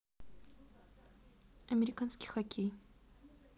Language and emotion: Russian, neutral